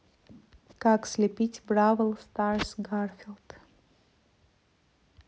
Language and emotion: Russian, neutral